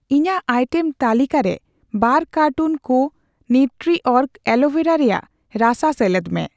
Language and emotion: Santali, neutral